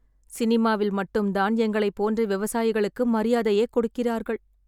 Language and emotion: Tamil, sad